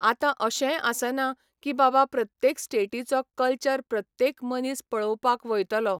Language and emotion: Goan Konkani, neutral